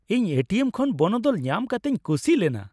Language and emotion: Santali, happy